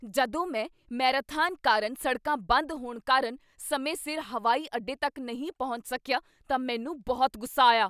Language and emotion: Punjabi, angry